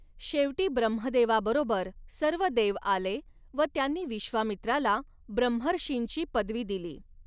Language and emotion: Marathi, neutral